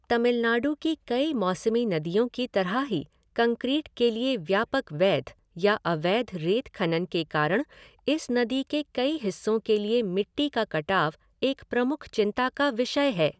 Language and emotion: Hindi, neutral